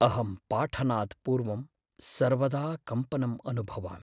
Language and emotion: Sanskrit, fearful